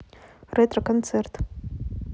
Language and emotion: Russian, neutral